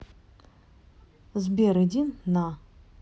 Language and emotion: Russian, neutral